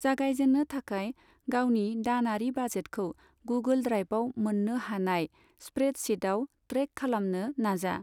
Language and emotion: Bodo, neutral